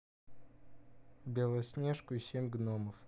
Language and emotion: Russian, neutral